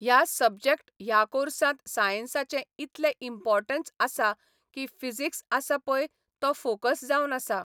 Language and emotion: Goan Konkani, neutral